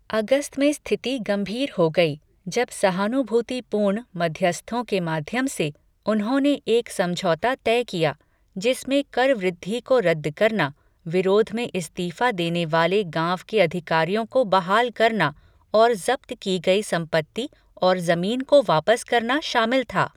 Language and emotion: Hindi, neutral